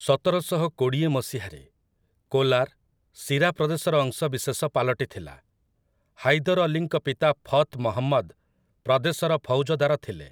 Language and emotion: Odia, neutral